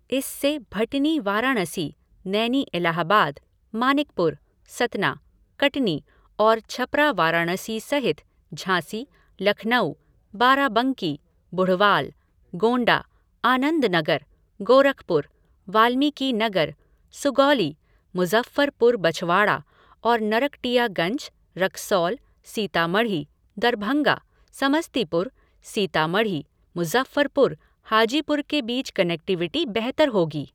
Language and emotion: Hindi, neutral